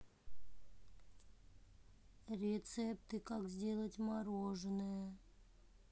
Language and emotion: Russian, sad